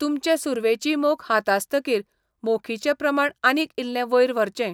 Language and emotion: Goan Konkani, neutral